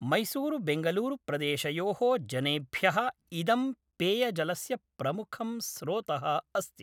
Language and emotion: Sanskrit, neutral